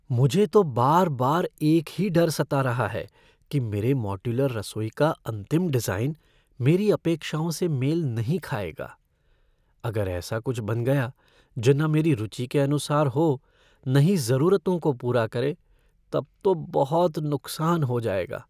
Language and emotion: Hindi, fearful